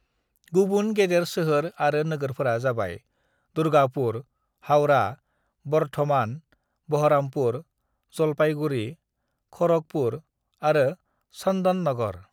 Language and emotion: Bodo, neutral